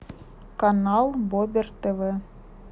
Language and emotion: Russian, neutral